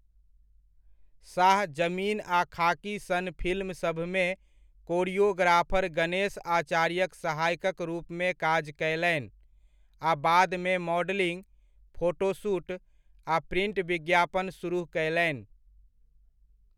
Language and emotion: Maithili, neutral